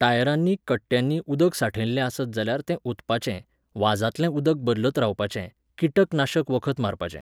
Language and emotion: Goan Konkani, neutral